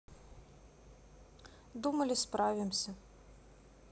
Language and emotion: Russian, sad